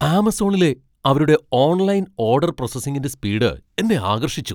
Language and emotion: Malayalam, surprised